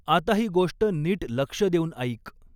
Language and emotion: Marathi, neutral